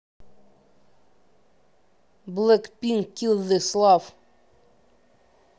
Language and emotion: Russian, neutral